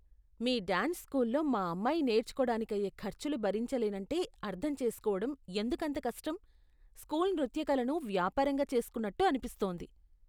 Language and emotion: Telugu, disgusted